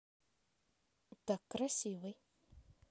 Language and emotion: Russian, neutral